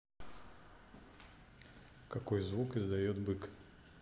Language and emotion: Russian, neutral